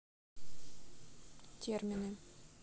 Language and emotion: Russian, neutral